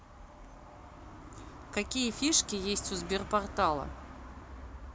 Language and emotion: Russian, neutral